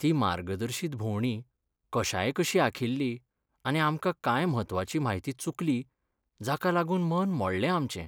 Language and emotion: Goan Konkani, sad